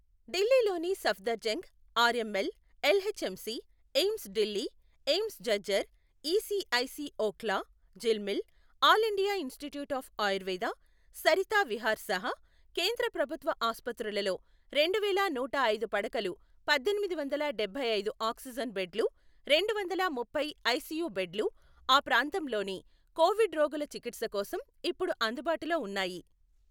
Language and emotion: Telugu, neutral